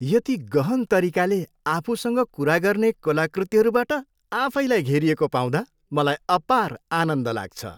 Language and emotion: Nepali, happy